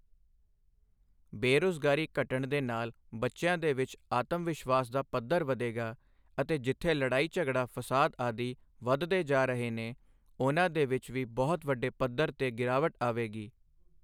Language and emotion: Punjabi, neutral